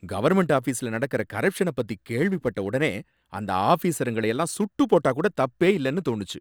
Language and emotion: Tamil, angry